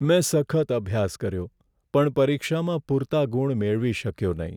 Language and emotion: Gujarati, sad